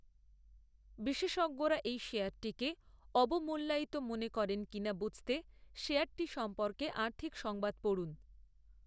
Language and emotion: Bengali, neutral